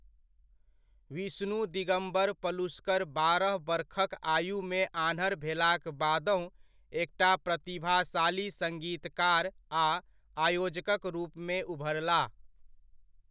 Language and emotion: Maithili, neutral